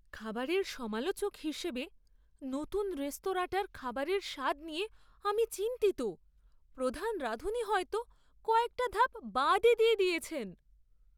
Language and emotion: Bengali, fearful